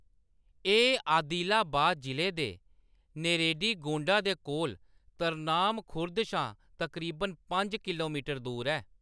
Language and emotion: Dogri, neutral